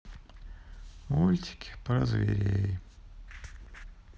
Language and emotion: Russian, sad